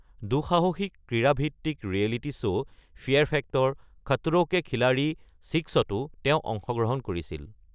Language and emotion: Assamese, neutral